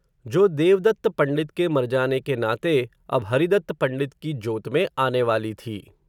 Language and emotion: Hindi, neutral